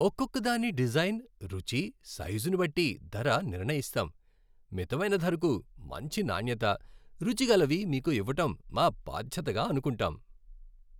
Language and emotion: Telugu, happy